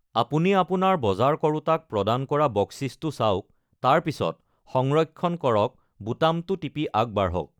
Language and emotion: Assamese, neutral